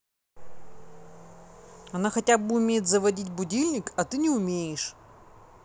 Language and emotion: Russian, neutral